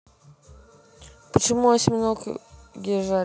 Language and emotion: Russian, neutral